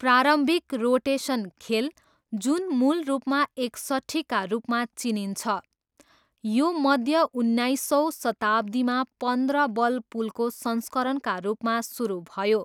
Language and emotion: Nepali, neutral